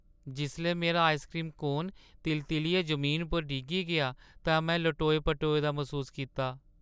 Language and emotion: Dogri, sad